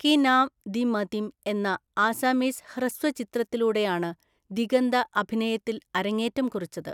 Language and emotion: Malayalam, neutral